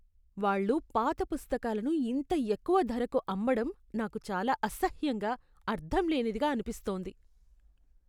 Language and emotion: Telugu, disgusted